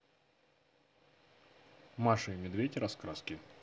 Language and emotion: Russian, neutral